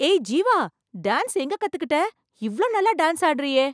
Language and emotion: Tamil, surprised